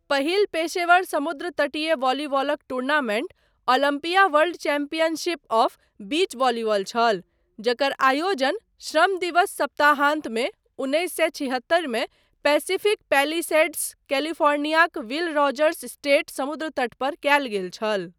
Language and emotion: Maithili, neutral